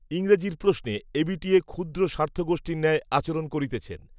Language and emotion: Bengali, neutral